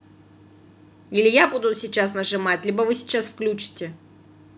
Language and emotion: Russian, angry